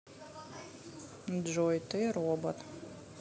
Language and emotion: Russian, neutral